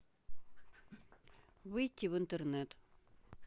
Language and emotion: Russian, neutral